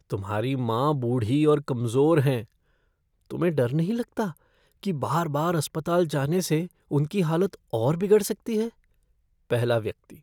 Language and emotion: Hindi, fearful